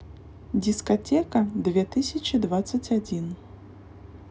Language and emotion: Russian, neutral